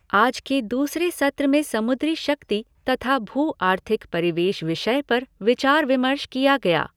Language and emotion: Hindi, neutral